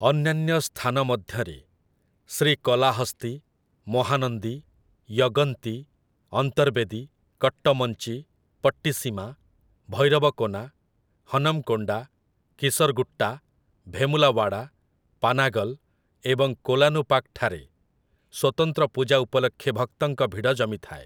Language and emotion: Odia, neutral